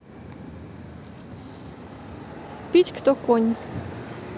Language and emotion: Russian, neutral